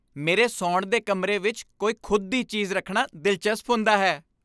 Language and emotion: Punjabi, happy